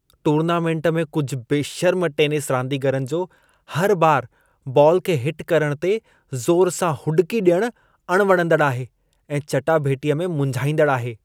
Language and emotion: Sindhi, disgusted